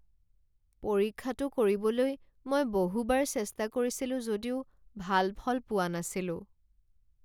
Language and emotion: Assamese, sad